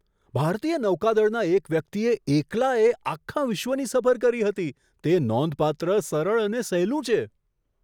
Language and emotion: Gujarati, surprised